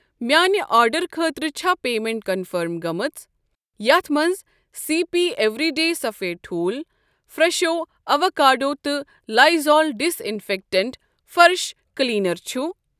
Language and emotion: Kashmiri, neutral